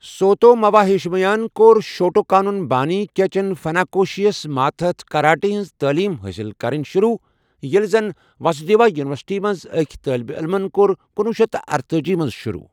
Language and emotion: Kashmiri, neutral